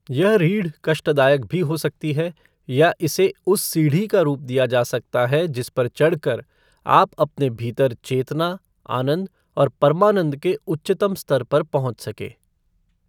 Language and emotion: Hindi, neutral